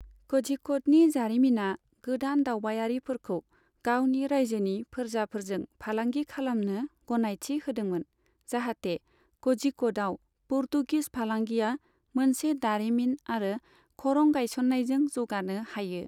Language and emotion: Bodo, neutral